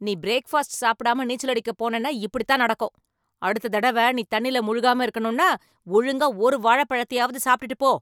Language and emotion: Tamil, angry